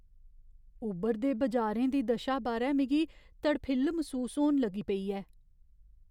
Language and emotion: Dogri, fearful